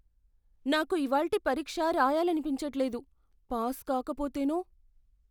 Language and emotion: Telugu, fearful